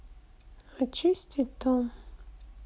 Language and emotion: Russian, sad